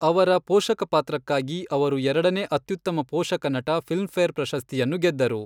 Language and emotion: Kannada, neutral